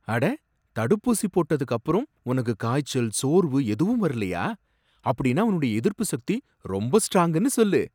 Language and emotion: Tamil, surprised